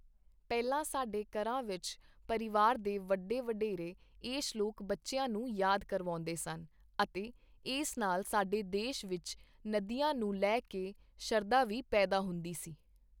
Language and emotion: Punjabi, neutral